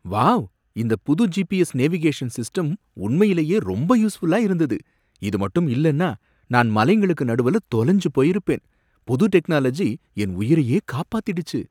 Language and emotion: Tamil, surprised